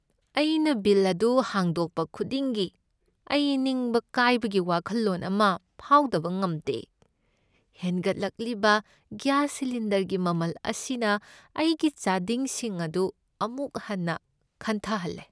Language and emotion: Manipuri, sad